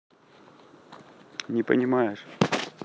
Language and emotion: Russian, neutral